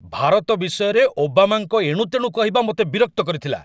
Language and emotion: Odia, angry